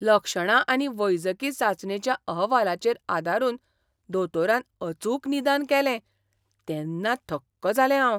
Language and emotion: Goan Konkani, surprised